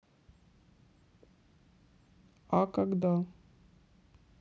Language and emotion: Russian, sad